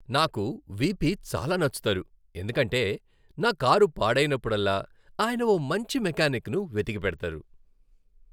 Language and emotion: Telugu, happy